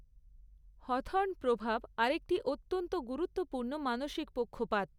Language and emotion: Bengali, neutral